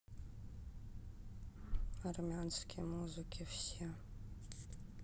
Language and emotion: Russian, sad